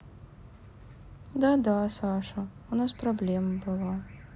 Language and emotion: Russian, sad